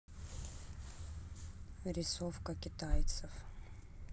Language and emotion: Russian, neutral